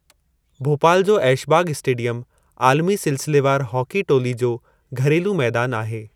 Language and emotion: Sindhi, neutral